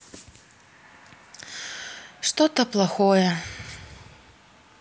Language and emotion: Russian, sad